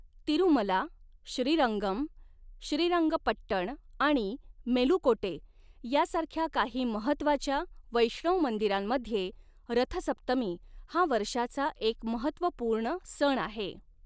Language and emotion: Marathi, neutral